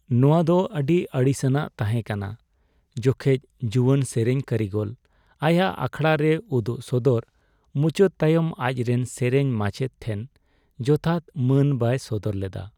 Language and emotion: Santali, sad